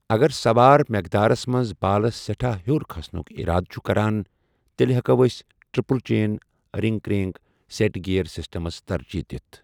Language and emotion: Kashmiri, neutral